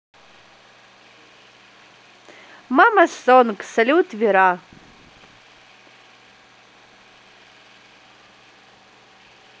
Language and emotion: Russian, positive